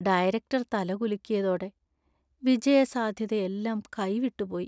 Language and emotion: Malayalam, sad